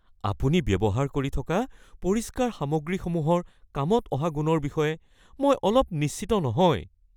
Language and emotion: Assamese, fearful